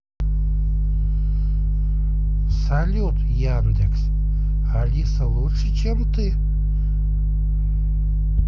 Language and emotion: Russian, neutral